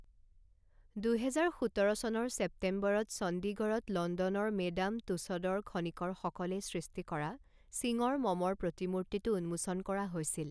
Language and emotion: Assamese, neutral